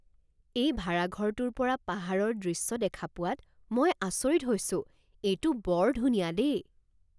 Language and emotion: Assamese, surprised